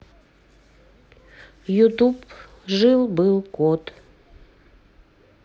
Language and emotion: Russian, neutral